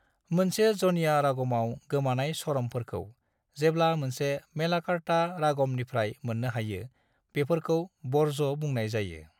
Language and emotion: Bodo, neutral